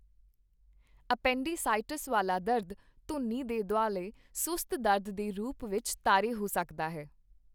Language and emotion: Punjabi, neutral